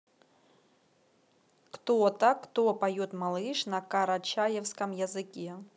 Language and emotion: Russian, neutral